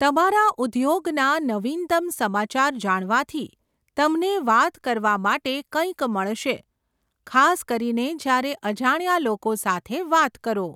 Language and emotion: Gujarati, neutral